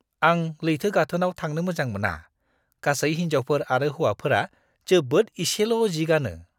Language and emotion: Bodo, disgusted